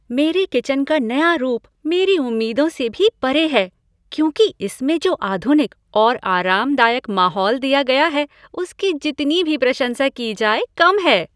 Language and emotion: Hindi, happy